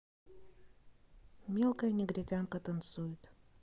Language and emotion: Russian, neutral